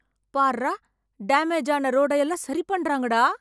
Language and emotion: Tamil, happy